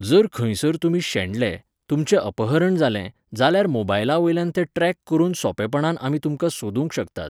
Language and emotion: Goan Konkani, neutral